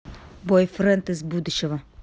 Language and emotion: Russian, angry